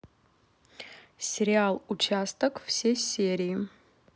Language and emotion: Russian, neutral